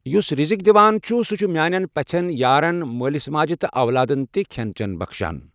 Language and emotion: Kashmiri, neutral